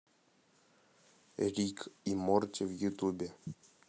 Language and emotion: Russian, neutral